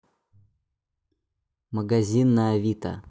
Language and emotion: Russian, neutral